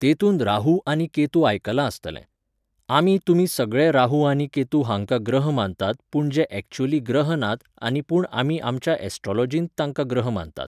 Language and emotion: Goan Konkani, neutral